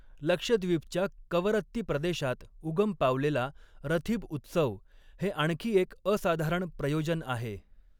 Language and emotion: Marathi, neutral